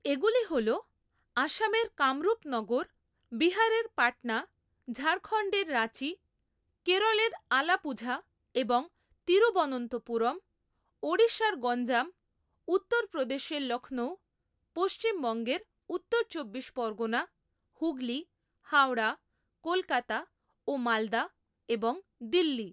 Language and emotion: Bengali, neutral